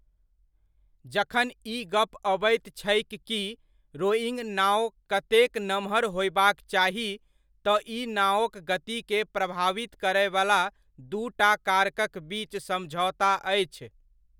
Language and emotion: Maithili, neutral